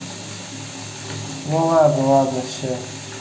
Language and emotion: Russian, neutral